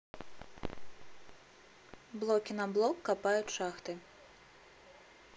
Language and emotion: Russian, neutral